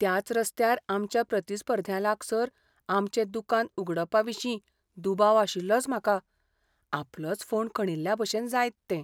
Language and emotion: Goan Konkani, fearful